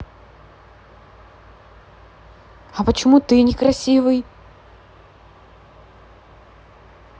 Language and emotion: Russian, neutral